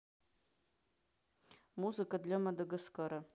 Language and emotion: Russian, neutral